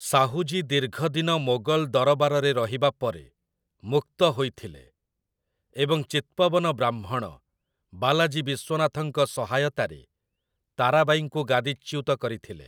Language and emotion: Odia, neutral